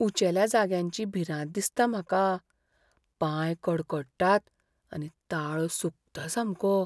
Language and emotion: Goan Konkani, fearful